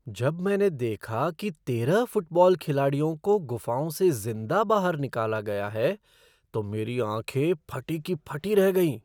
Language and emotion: Hindi, surprised